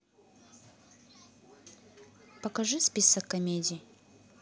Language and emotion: Russian, neutral